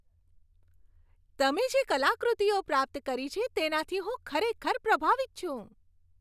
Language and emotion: Gujarati, happy